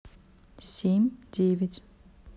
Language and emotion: Russian, neutral